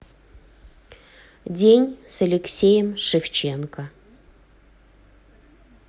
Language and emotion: Russian, neutral